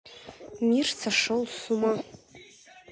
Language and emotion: Russian, neutral